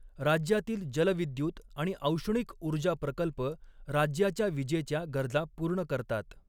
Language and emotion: Marathi, neutral